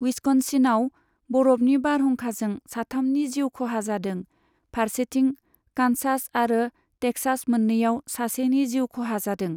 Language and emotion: Bodo, neutral